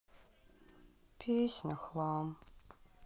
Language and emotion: Russian, sad